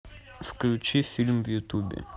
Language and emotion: Russian, neutral